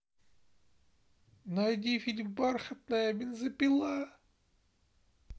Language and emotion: Russian, sad